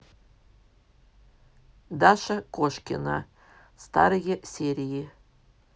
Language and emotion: Russian, neutral